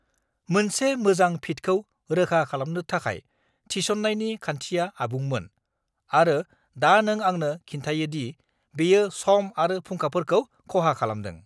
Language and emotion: Bodo, angry